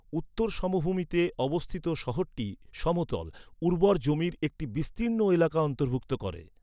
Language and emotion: Bengali, neutral